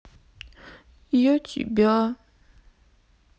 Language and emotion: Russian, sad